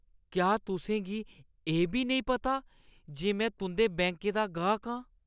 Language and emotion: Dogri, disgusted